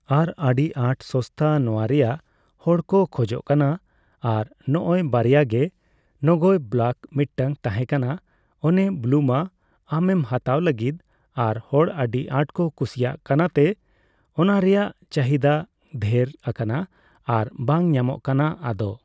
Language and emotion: Santali, neutral